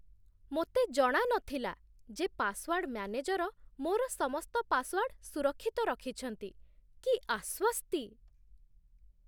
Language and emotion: Odia, surprised